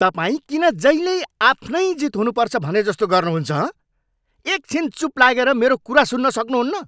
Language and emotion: Nepali, angry